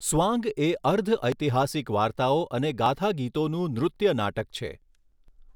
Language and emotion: Gujarati, neutral